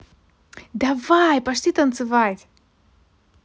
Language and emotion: Russian, positive